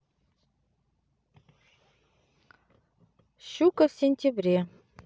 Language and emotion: Russian, neutral